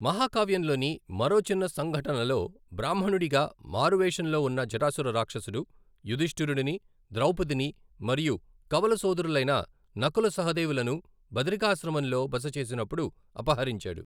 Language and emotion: Telugu, neutral